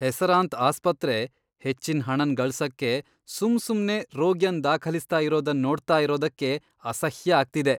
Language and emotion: Kannada, disgusted